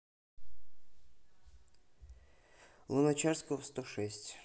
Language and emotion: Russian, neutral